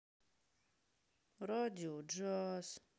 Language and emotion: Russian, sad